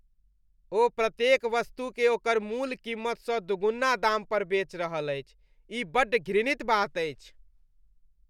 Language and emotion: Maithili, disgusted